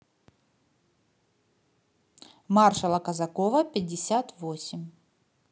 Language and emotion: Russian, positive